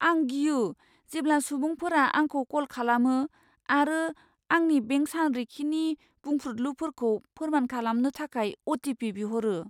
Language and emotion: Bodo, fearful